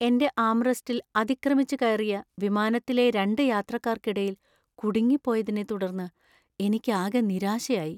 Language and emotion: Malayalam, sad